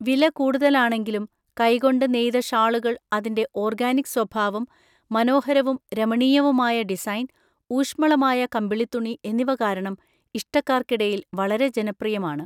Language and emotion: Malayalam, neutral